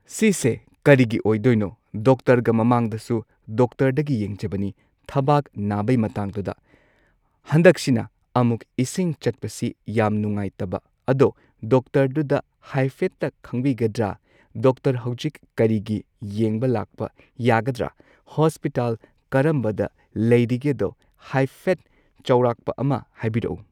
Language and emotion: Manipuri, neutral